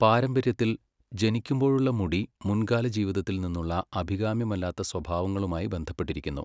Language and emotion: Malayalam, neutral